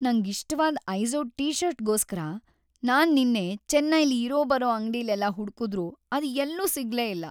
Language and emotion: Kannada, sad